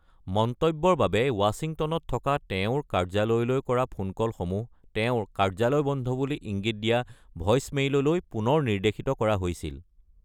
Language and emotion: Assamese, neutral